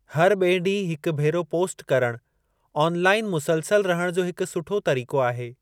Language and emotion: Sindhi, neutral